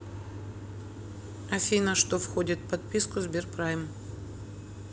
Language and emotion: Russian, neutral